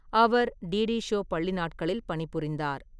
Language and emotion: Tamil, neutral